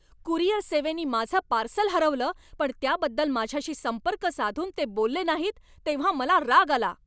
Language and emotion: Marathi, angry